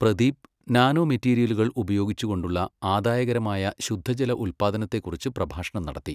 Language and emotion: Malayalam, neutral